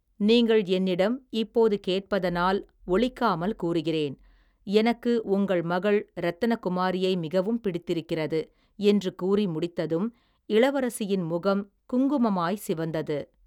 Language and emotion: Tamil, neutral